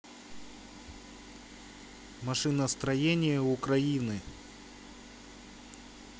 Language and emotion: Russian, neutral